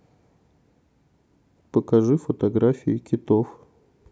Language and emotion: Russian, neutral